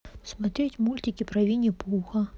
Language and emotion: Russian, neutral